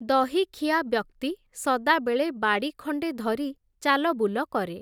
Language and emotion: Odia, neutral